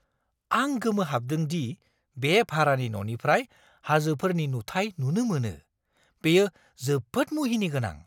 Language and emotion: Bodo, surprised